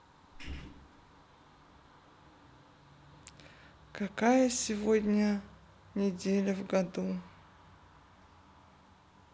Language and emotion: Russian, neutral